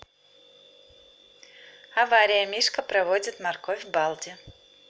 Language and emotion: Russian, neutral